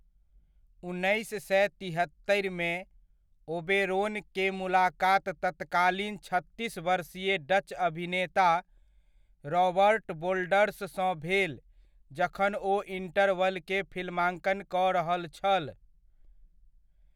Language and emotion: Maithili, neutral